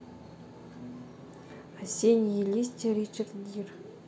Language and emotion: Russian, neutral